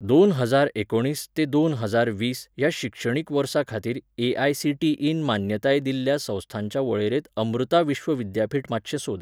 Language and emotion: Goan Konkani, neutral